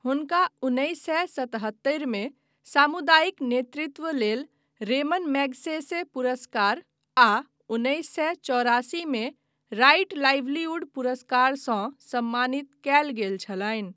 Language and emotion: Maithili, neutral